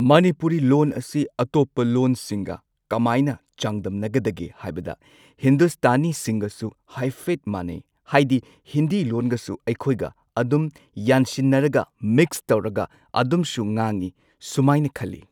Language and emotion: Manipuri, neutral